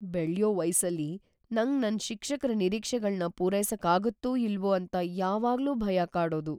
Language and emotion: Kannada, fearful